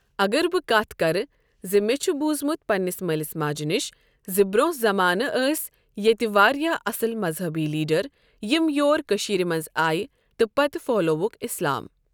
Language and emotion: Kashmiri, neutral